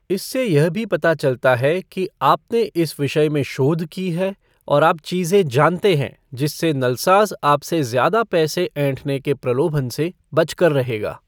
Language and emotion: Hindi, neutral